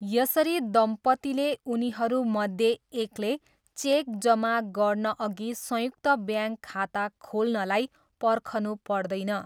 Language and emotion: Nepali, neutral